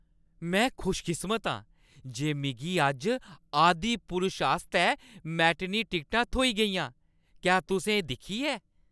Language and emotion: Dogri, happy